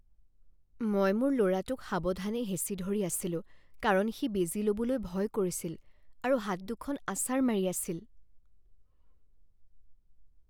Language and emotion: Assamese, fearful